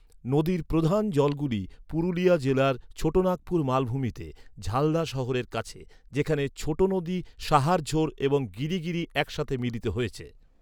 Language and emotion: Bengali, neutral